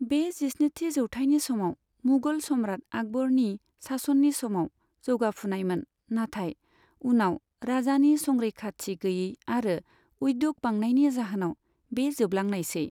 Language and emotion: Bodo, neutral